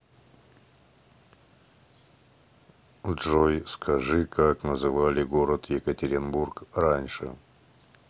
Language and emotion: Russian, neutral